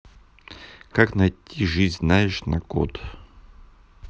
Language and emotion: Russian, neutral